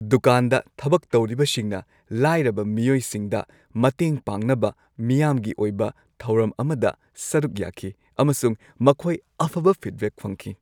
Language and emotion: Manipuri, happy